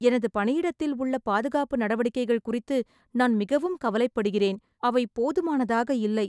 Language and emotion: Tamil, sad